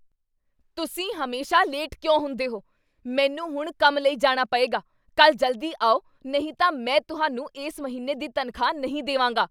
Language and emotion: Punjabi, angry